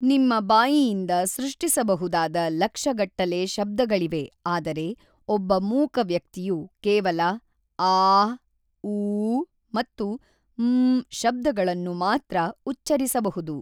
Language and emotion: Kannada, neutral